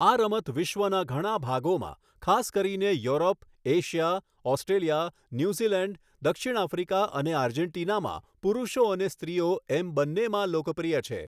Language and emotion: Gujarati, neutral